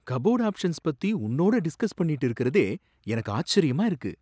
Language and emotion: Tamil, surprised